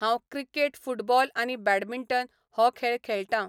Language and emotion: Goan Konkani, neutral